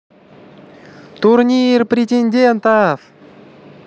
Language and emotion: Russian, positive